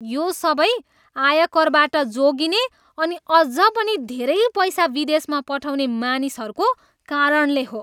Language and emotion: Nepali, disgusted